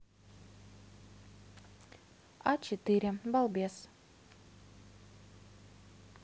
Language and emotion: Russian, neutral